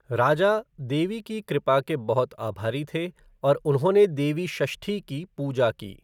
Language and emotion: Hindi, neutral